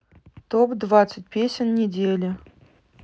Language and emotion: Russian, neutral